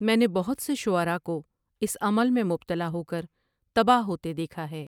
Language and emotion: Urdu, neutral